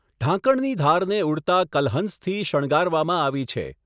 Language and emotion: Gujarati, neutral